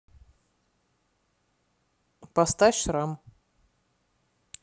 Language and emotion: Russian, neutral